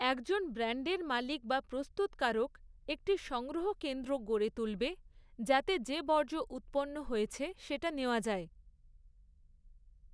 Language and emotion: Bengali, neutral